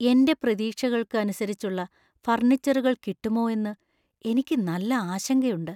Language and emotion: Malayalam, fearful